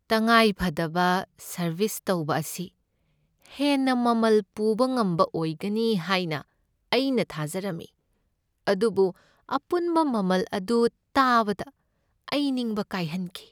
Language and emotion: Manipuri, sad